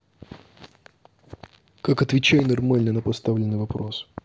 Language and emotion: Russian, angry